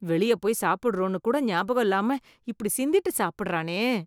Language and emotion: Tamil, disgusted